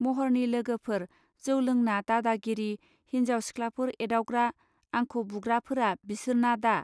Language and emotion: Bodo, neutral